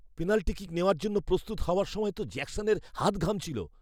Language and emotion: Bengali, fearful